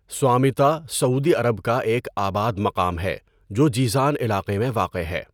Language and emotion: Urdu, neutral